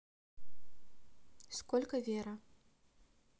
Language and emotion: Russian, neutral